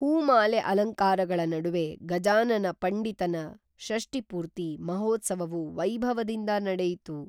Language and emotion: Kannada, neutral